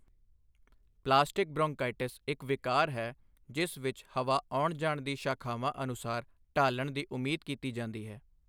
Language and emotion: Punjabi, neutral